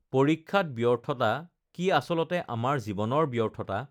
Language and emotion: Assamese, neutral